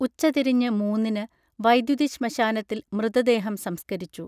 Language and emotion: Malayalam, neutral